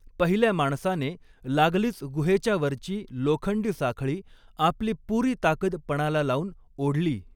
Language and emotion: Marathi, neutral